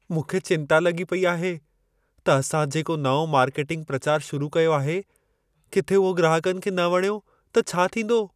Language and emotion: Sindhi, fearful